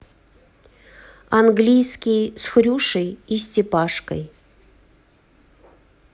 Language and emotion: Russian, neutral